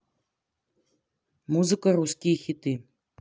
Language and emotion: Russian, neutral